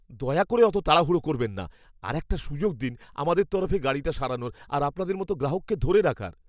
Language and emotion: Bengali, fearful